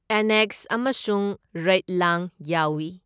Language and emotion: Manipuri, neutral